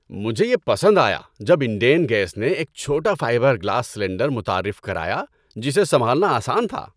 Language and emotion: Urdu, happy